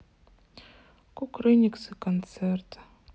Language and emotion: Russian, sad